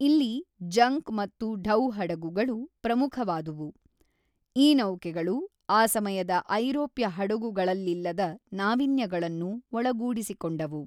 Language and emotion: Kannada, neutral